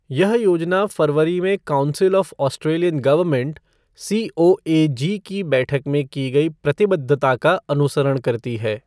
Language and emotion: Hindi, neutral